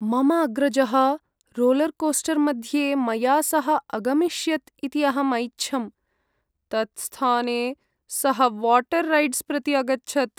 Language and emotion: Sanskrit, sad